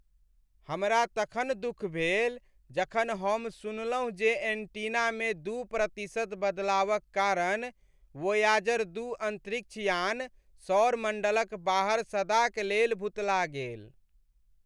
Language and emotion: Maithili, sad